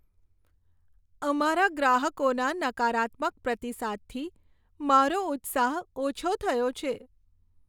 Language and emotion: Gujarati, sad